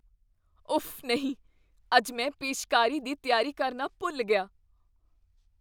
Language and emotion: Punjabi, fearful